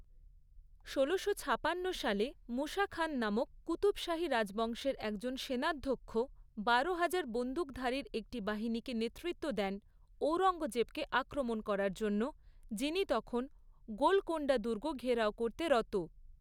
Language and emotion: Bengali, neutral